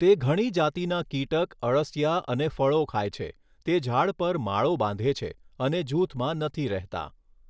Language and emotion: Gujarati, neutral